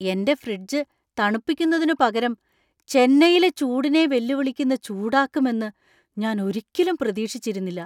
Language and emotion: Malayalam, surprised